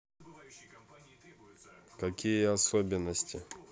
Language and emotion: Russian, neutral